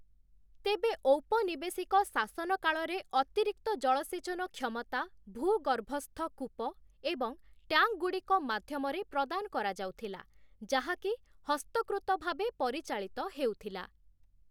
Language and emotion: Odia, neutral